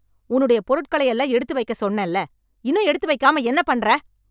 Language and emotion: Tamil, angry